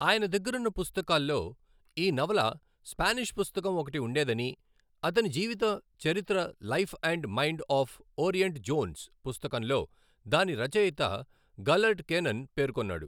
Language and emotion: Telugu, neutral